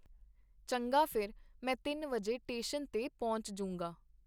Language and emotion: Punjabi, neutral